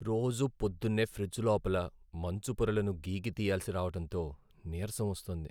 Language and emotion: Telugu, sad